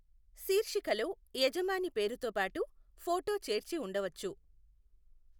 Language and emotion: Telugu, neutral